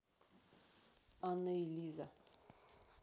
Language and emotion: Russian, neutral